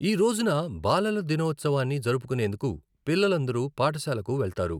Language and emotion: Telugu, neutral